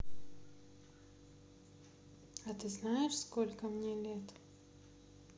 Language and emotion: Russian, sad